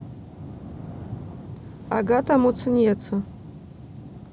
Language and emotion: Russian, neutral